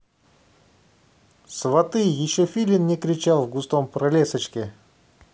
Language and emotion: Russian, positive